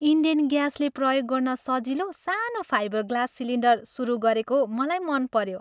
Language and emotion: Nepali, happy